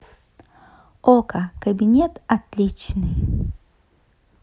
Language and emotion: Russian, positive